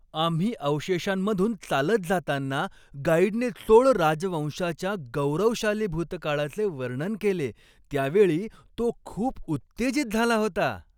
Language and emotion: Marathi, happy